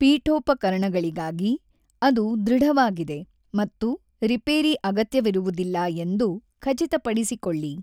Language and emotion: Kannada, neutral